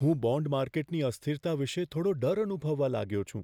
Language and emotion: Gujarati, fearful